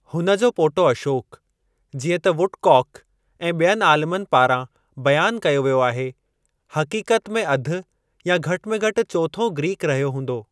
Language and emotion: Sindhi, neutral